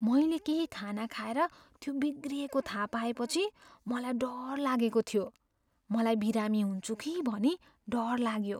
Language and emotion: Nepali, fearful